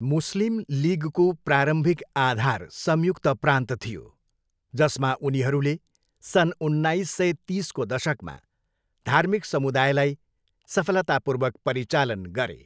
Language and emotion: Nepali, neutral